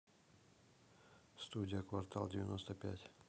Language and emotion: Russian, neutral